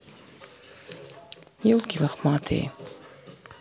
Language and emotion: Russian, sad